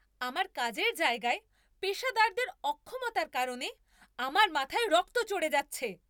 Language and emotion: Bengali, angry